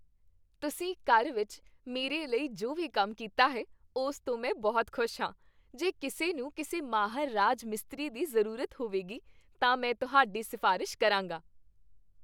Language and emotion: Punjabi, happy